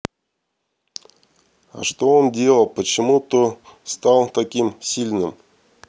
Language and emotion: Russian, neutral